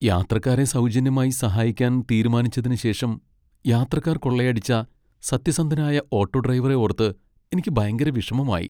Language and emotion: Malayalam, sad